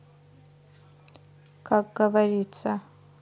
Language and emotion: Russian, neutral